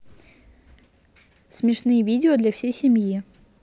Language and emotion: Russian, neutral